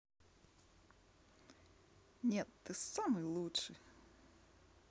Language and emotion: Russian, positive